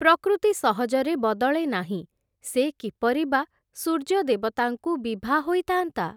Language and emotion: Odia, neutral